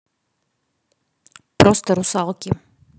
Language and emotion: Russian, neutral